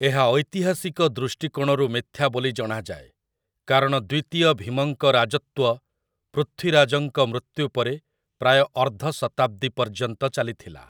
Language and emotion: Odia, neutral